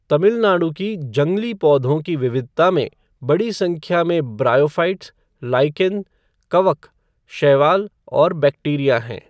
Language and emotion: Hindi, neutral